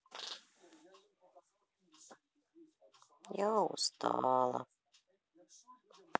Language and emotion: Russian, sad